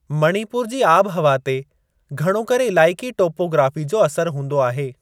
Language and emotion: Sindhi, neutral